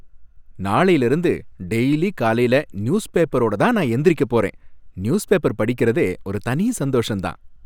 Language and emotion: Tamil, happy